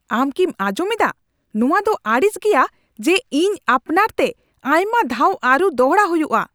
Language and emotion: Santali, angry